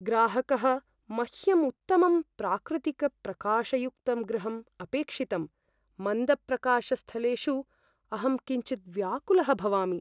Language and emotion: Sanskrit, fearful